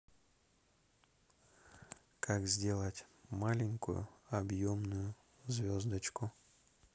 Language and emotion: Russian, neutral